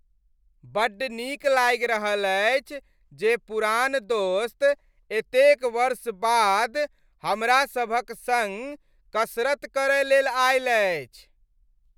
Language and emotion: Maithili, happy